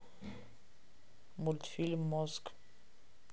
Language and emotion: Russian, neutral